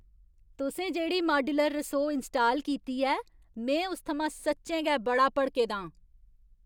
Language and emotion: Dogri, angry